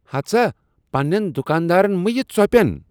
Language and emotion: Kashmiri, disgusted